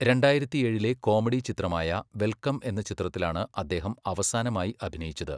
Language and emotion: Malayalam, neutral